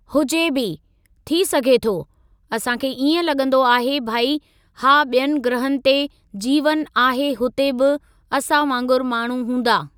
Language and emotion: Sindhi, neutral